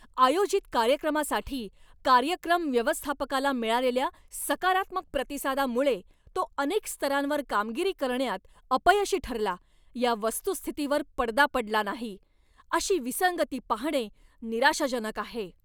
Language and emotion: Marathi, angry